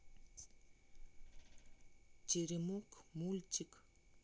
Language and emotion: Russian, neutral